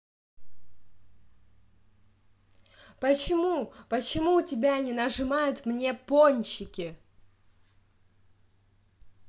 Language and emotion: Russian, angry